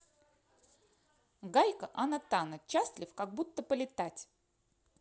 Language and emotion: Russian, positive